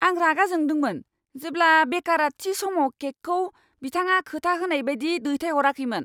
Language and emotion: Bodo, angry